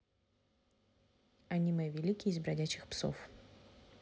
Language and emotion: Russian, neutral